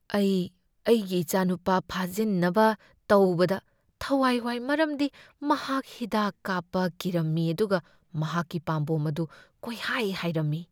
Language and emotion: Manipuri, fearful